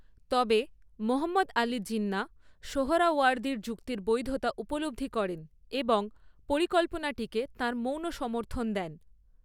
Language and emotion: Bengali, neutral